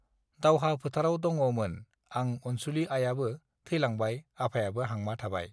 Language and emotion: Bodo, neutral